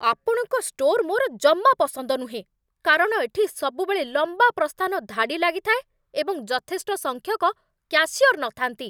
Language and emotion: Odia, angry